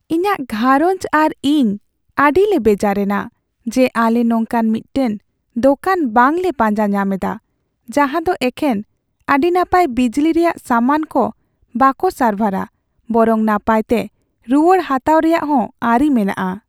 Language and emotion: Santali, sad